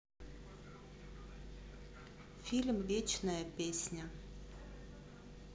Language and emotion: Russian, neutral